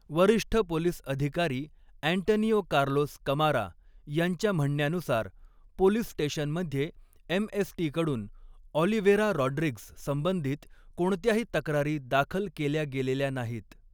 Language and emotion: Marathi, neutral